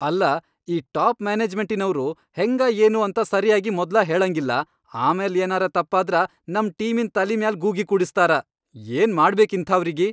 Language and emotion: Kannada, angry